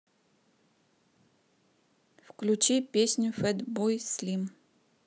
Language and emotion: Russian, neutral